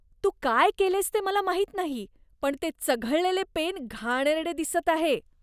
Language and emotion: Marathi, disgusted